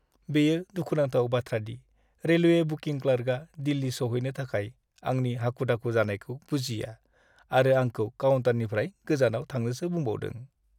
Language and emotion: Bodo, sad